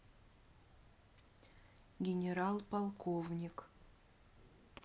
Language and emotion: Russian, neutral